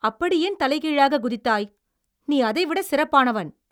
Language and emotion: Tamil, angry